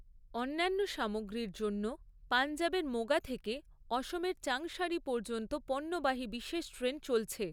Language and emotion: Bengali, neutral